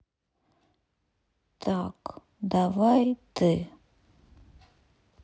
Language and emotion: Russian, sad